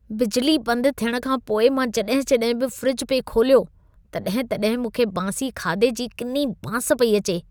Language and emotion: Sindhi, disgusted